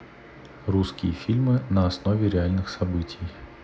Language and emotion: Russian, neutral